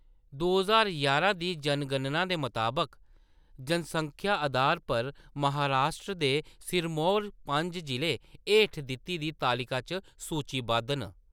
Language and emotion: Dogri, neutral